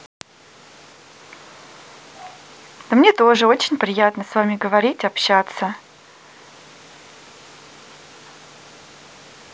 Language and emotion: Russian, positive